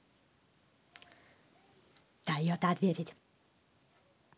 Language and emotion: Russian, angry